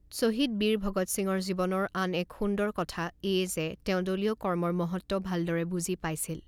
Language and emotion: Assamese, neutral